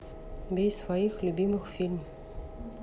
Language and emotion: Russian, neutral